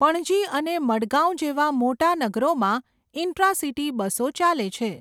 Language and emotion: Gujarati, neutral